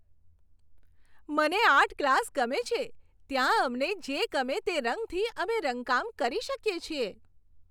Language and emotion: Gujarati, happy